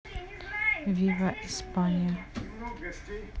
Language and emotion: Russian, neutral